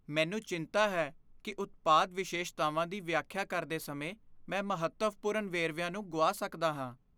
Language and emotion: Punjabi, fearful